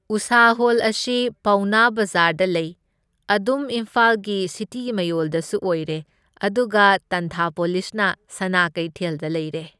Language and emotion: Manipuri, neutral